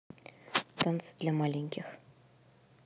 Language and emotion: Russian, neutral